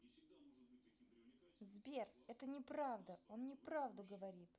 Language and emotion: Russian, angry